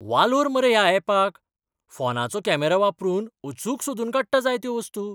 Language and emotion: Goan Konkani, surprised